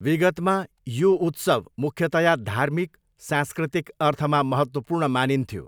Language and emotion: Nepali, neutral